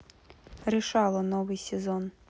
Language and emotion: Russian, neutral